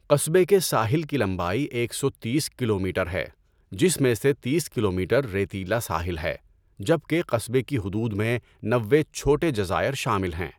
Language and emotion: Urdu, neutral